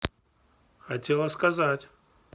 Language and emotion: Russian, neutral